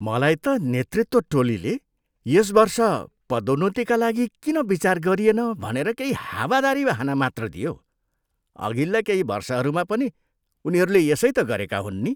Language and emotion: Nepali, disgusted